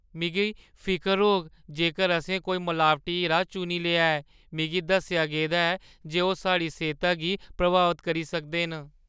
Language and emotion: Dogri, fearful